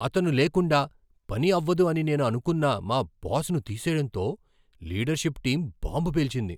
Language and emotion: Telugu, surprised